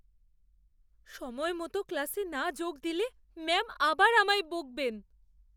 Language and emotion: Bengali, fearful